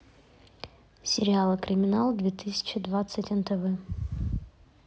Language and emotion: Russian, neutral